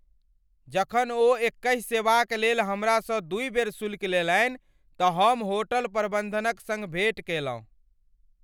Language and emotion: Maithili, angry